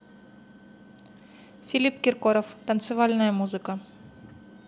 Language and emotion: Russian, neutral